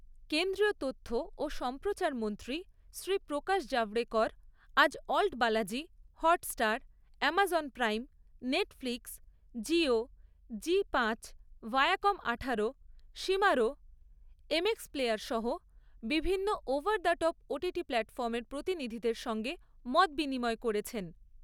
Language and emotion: Bengali, neutral